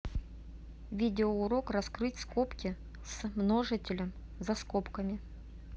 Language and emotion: Russian, neutral